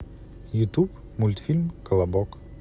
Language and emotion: Russian, neutral